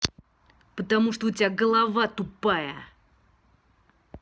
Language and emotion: Russian, angry